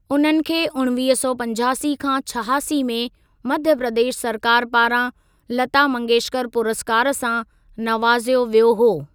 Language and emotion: Sindhi, neutral